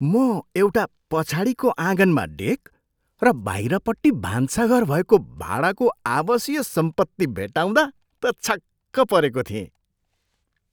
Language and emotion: Nepali, surprised